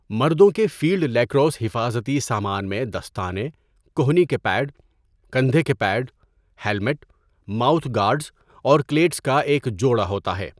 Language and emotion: Urdu, neutral